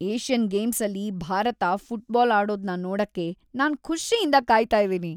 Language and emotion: Kannada, happy